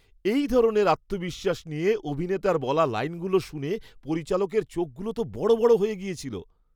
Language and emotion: Bengali, surprised